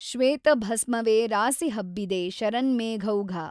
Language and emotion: Kannada, neutral